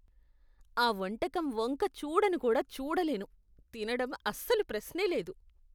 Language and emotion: Telugu, disgusted